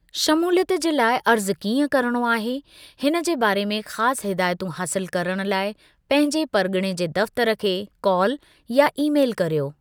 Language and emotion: Sindhi, neutral